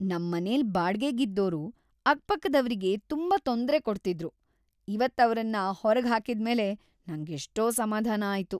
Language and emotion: Kannada, happy